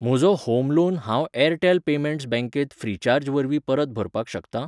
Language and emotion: Goan Konkani, neutral